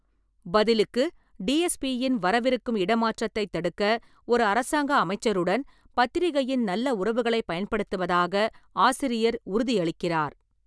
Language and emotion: Tamil, neutral